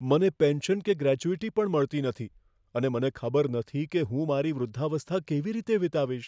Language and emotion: Gujarati, fearful